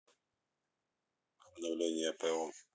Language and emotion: Russian, neutral